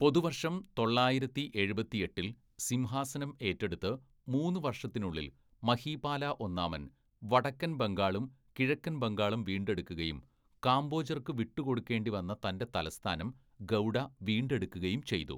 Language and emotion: Malayalam, neutral